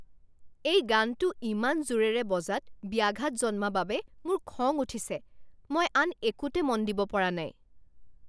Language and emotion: Assamese, angry